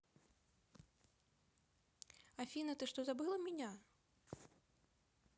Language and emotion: Russian, neutral